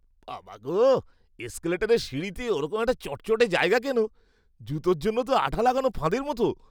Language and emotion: Bengali, disgusted